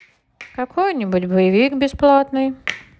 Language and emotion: Russian, neutral